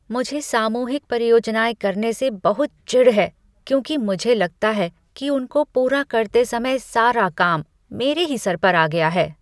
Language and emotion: Hindi, disgusted